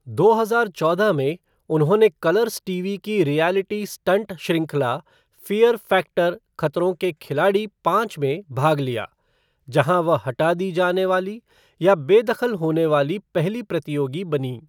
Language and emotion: Hindi, neutral